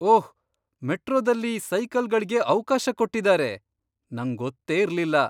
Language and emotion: Kannada, surprised